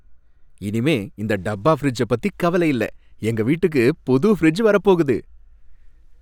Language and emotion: Tamil, happy